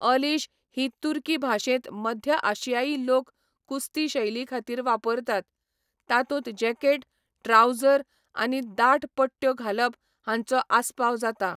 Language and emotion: Goan Konkani, neutral